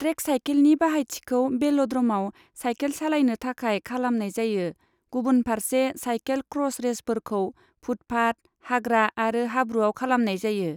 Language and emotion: Bodo, neutral